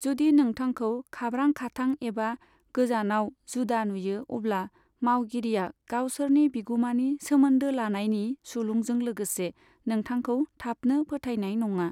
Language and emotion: Bodo, neutral